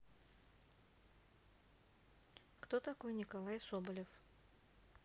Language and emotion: Russian, neutral